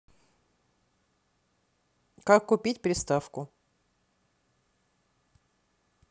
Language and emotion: Russian, neutral